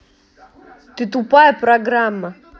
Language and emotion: Russian, angry